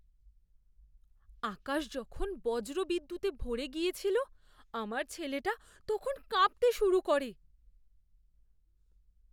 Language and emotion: Bengali, fearful